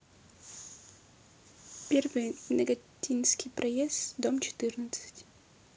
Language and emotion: Russian, neutral